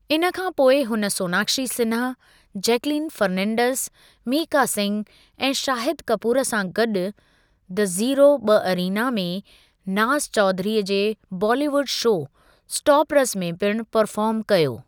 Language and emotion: Sindhi, neutral